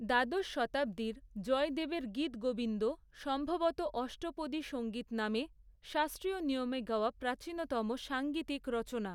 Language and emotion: Bengali, neutral